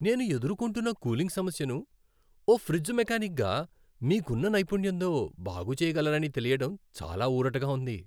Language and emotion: Telugu, happy